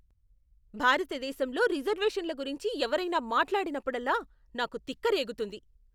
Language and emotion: Telugu, angry